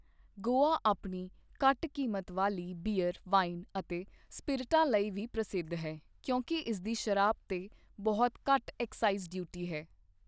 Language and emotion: Punjabi, neutral